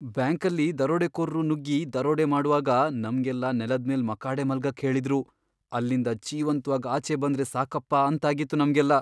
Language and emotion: Kannada, fearful